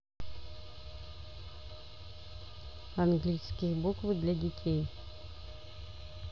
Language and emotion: Russian, neutral